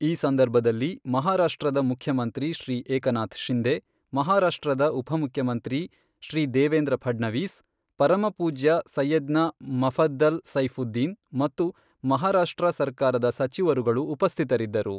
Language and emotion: Kannada, neutral